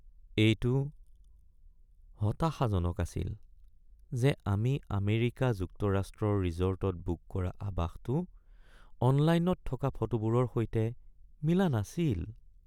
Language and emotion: Assamese, sad